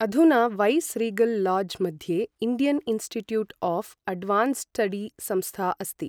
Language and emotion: Sanskrit, neutral